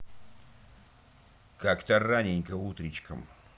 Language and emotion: Russian, angry